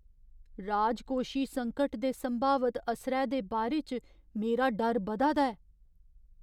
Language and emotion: Dogri, fearful